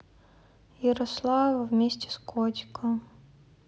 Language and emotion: Russian, sad